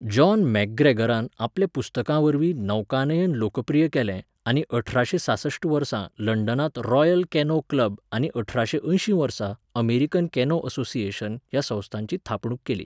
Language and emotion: Goan Konkani, neutral